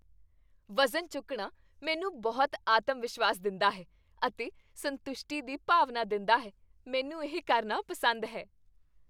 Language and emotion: Punjabi, happy